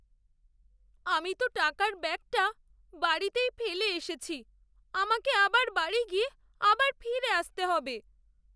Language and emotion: Bengali, sad